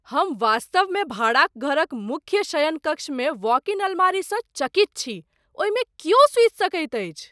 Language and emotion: Maithili, surprised